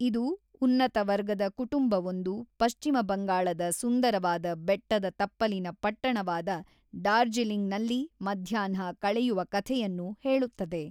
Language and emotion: Kannada, neutral